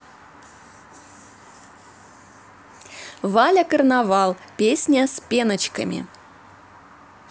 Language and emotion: Russian, positive